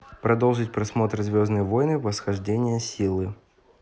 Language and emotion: Russian, neutral